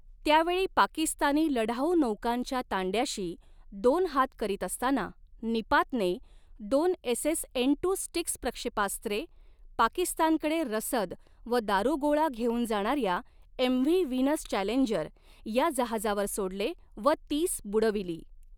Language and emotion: Marathi, neutral